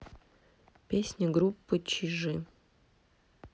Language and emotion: Russian, neutral